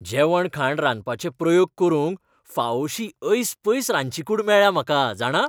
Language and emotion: Goan Konkani, happy